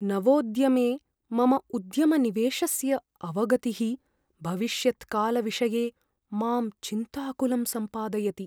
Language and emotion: Sanskrit, fearful